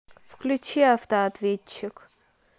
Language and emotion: Russian, neutral